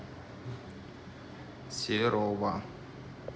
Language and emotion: Russian, neutral